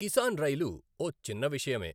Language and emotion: Telugu, neutral